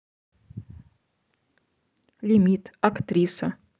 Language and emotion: Russian, neutral